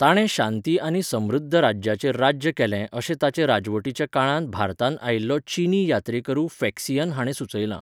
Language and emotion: Goan Konkani, neutral